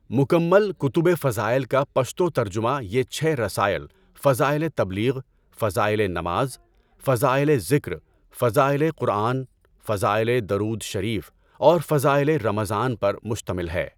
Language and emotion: Urdu, neutral